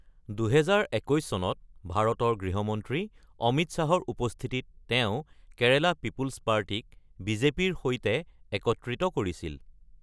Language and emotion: Assamese, neutral